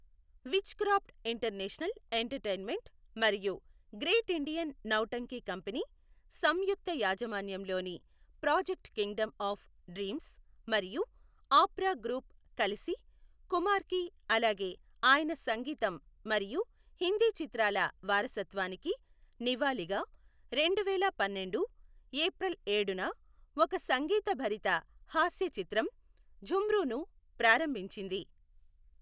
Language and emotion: Telugu, neutral